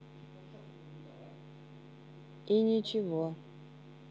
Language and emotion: Russian, neutral